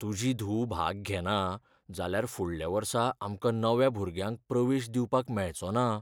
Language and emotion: Goan Konkani, fearful